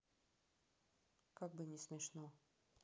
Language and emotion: Russian, neutral